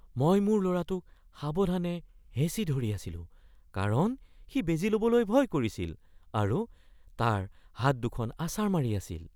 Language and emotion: Assamese, fearful